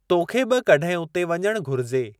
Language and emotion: Sindhi, neutral